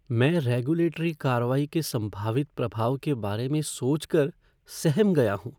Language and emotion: Hindi, fearful